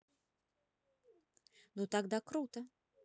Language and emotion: Russian, positive